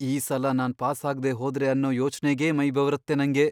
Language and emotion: Kannada, fearful